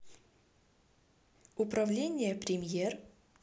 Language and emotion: Russian, neutral